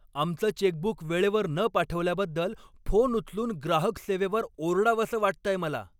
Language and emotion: Marathi, angry